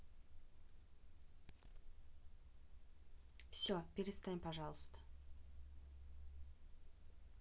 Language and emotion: Russian, neutral